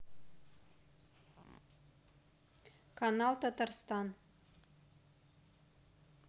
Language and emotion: Russian, neutral